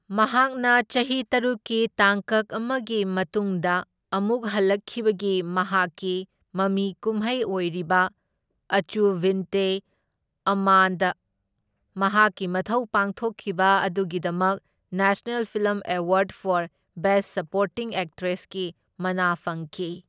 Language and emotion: Manipuri, neutral